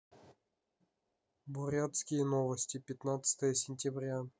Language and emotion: Russian, neutral